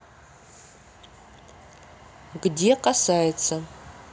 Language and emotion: Russian, neutral